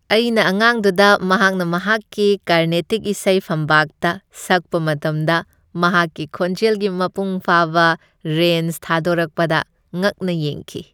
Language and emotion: Manipuri, happy